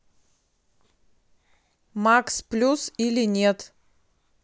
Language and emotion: Russian, neutral